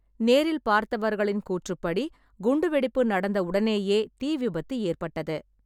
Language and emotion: Tamil, neutral